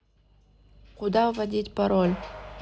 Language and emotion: Russian, neutral